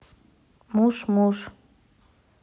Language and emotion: Russian, neutral